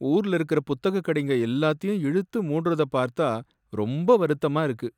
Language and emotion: Tamil, sad